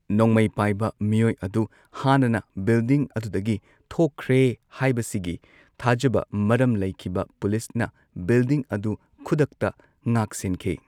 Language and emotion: Manipuri, neutral